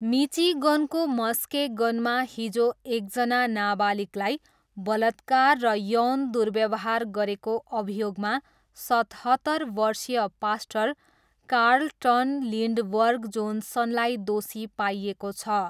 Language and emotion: Nepali, neutral